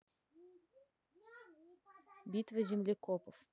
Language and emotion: Russian, neutral